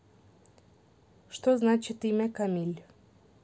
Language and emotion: Russian, neutral